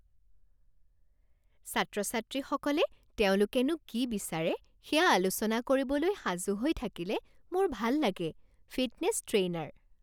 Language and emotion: Assamese, happy